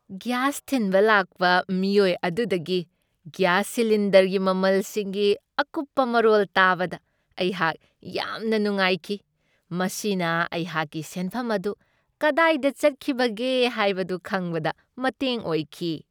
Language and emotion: Manipuri, happy